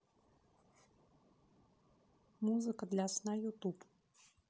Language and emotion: Russian, neutral